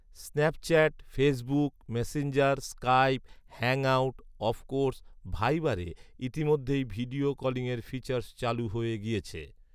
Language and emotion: Bengali, neutral